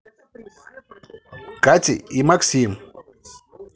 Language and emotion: Russian, positive